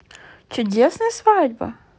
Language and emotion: Russian, positive